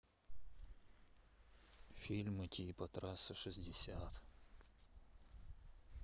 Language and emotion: Russian, sad